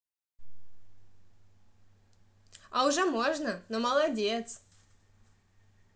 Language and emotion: Russian, positive